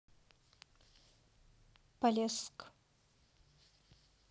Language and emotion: Russian, neutral